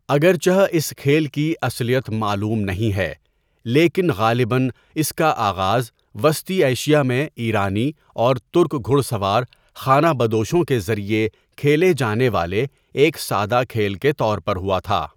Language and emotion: Urdu, neutral